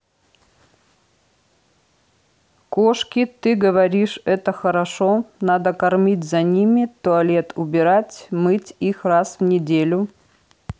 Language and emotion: Russian, neutral